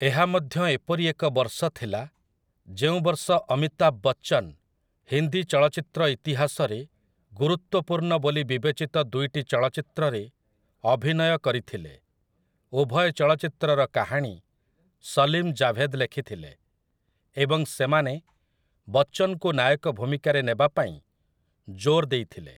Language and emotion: Odia, neutral